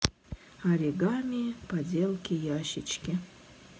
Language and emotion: Russian, sad